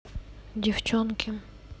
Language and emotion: Russian, neutral